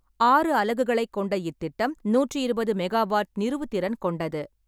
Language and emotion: Tamil, neutral